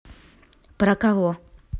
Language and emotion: Russian, neutral